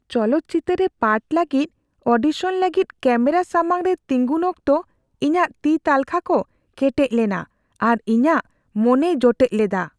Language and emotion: Santali, fearful